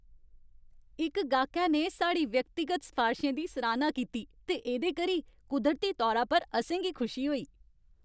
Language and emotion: Dogri, happy